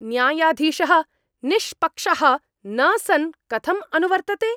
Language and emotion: Sanskrit, angry